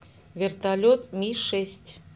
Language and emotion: Russian, neutral